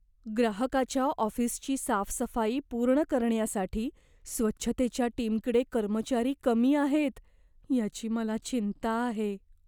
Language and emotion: Marathi, fearful